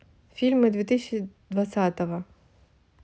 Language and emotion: Russian, neutral